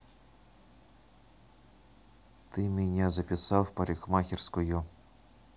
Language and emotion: Russian, neutral